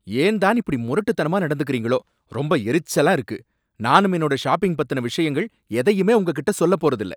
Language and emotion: Tamil, angry